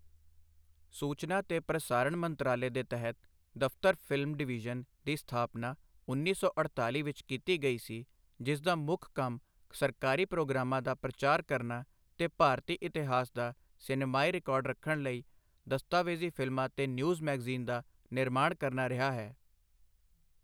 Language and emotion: Punjabi, neutral